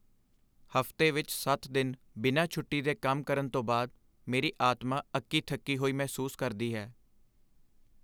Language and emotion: Punjabi, sad